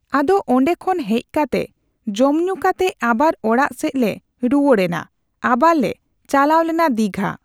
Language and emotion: Santali, neutral